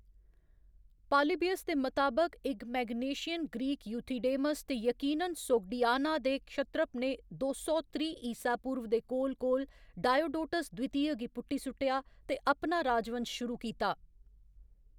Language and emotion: Dogri, neutral